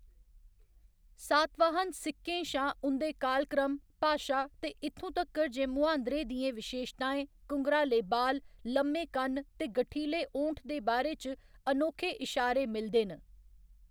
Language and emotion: Dogri, neutral